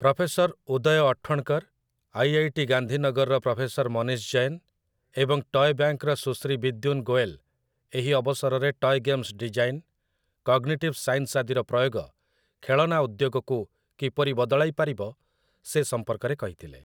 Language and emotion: Odia, neutral